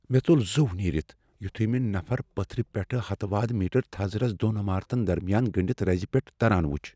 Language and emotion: Kashmiri, fearful